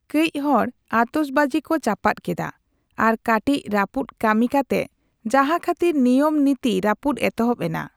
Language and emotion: Santali, neutral